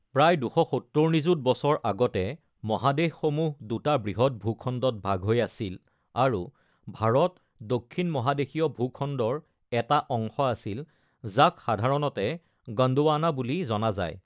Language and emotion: Assamese, neutral